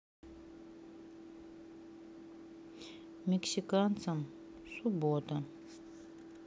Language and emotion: Russian, sad